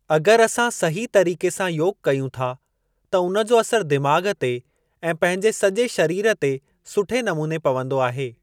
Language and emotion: Sindhi, neutral